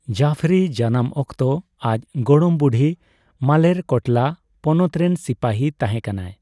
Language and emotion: Santali, neutral